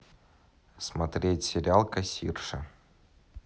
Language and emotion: Russian, neutral